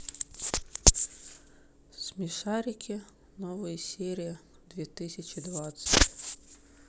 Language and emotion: Russian, sad